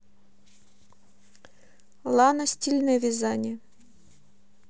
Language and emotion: Russian, neutral